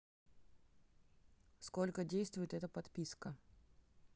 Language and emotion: Russian, neutral